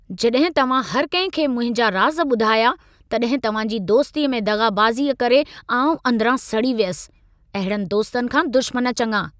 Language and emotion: Sindhi, angry